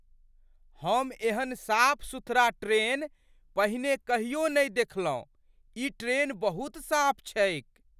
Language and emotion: Maithili, surprised